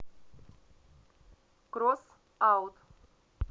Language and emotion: Russian, neutral